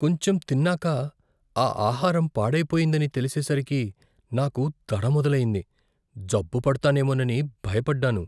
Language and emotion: Telugu, fearful